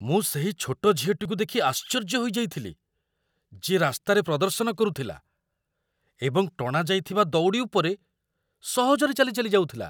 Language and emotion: Odia, surprised